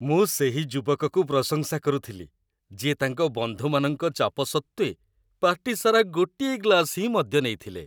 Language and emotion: Odia, happy